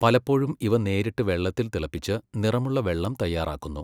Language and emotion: Malayalam, neutral